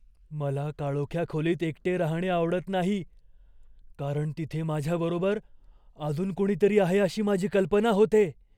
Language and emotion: Marathi, fearful